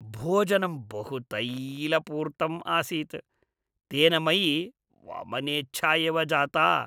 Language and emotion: Sanskrit, disgusted